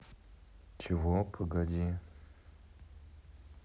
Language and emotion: Russian, neutral